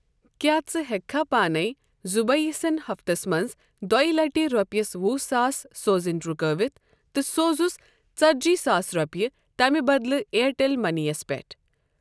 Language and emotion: Kashmiri, neutral